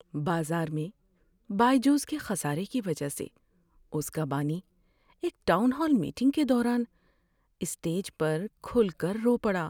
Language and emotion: Urdu, sad